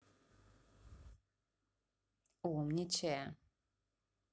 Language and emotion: Russian, positive